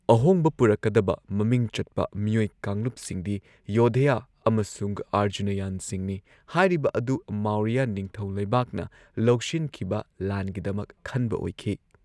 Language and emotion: Manipuri, neutral